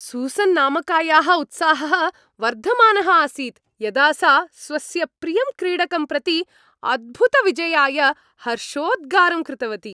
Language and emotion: Sanskrit, happy